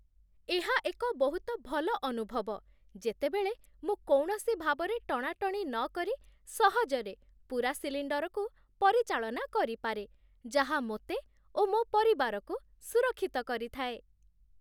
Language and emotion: Odia, happy